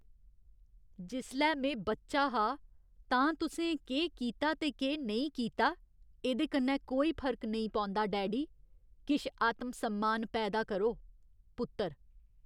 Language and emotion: Dogri, disgusted